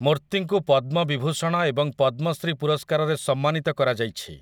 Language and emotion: Odia, neutral